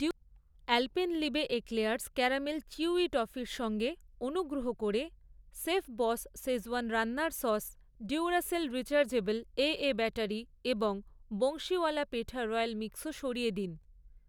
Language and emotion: Bengali, neutral